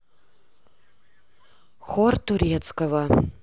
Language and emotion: Russian, neutral